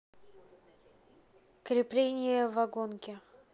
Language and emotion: Russian, neutral